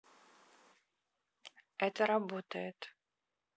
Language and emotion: Russian, neutral